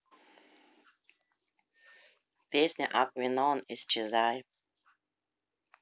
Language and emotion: Russian, neutral